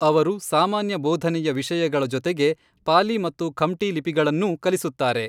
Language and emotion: Kannada, neutral